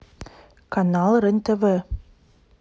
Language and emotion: Russian, neutral